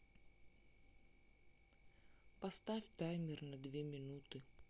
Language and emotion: Russian, sad